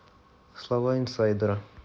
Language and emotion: Russian, neutral